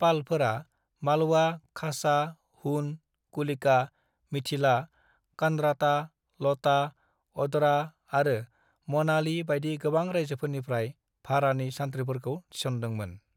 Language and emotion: Bodo, neutral